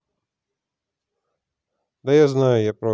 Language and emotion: Russian, neutral